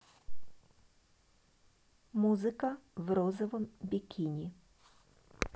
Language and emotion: Russian, neutral